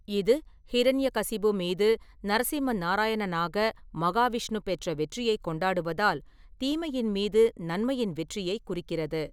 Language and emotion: Tamil, neutral